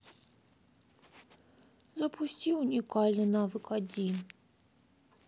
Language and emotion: Russian, sad